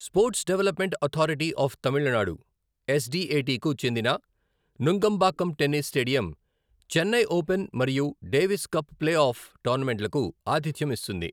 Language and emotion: Telugu, neutral